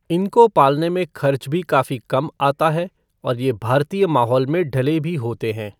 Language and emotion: Hindi, neutral